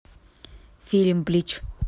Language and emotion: Russian, neutral